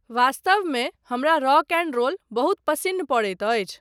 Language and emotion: Maithili, neutral